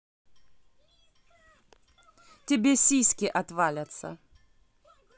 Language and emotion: Russian, angry